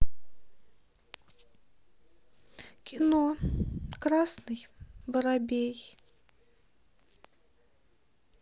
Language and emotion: Russian, sad